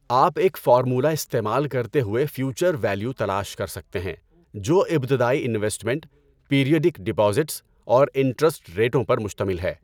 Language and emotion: Urdu, neutral